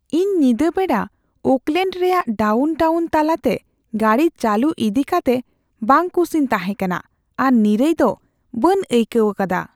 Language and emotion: Santali, fearful